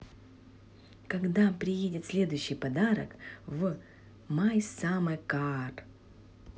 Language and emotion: Russian, positive